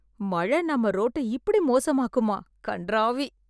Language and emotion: Tamil, disgusted